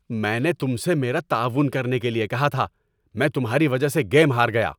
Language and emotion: Urdu, angry